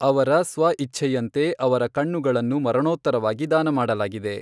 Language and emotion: Kannada, neutral